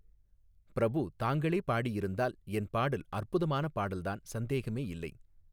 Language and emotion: Tamil, neutral